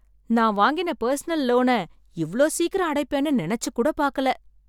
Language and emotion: Tamil, surprised